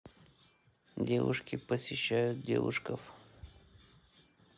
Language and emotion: Russian, neutral